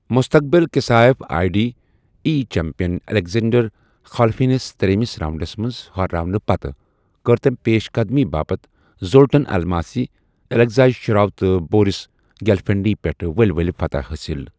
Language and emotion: Kashmiri, neutral